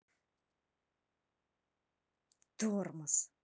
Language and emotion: Russian, angry